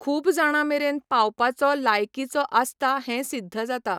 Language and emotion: Goan Konkani, neutral